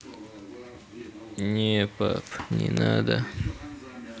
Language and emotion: Russian, sad